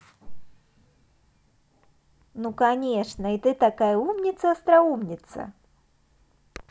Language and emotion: Russian, positive